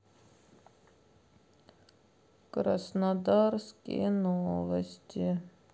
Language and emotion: Russian, sad